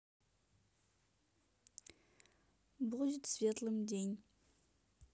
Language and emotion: Russian, neutral